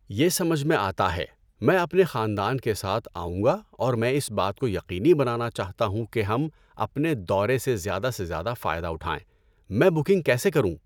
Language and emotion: Urdu, neutral